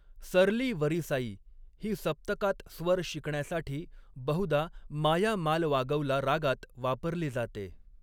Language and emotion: Marathi, neutral